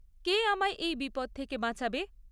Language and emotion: Bengali, neutral